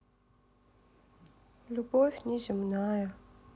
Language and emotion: Russian, sad